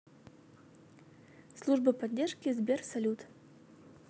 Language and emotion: Russian, neutral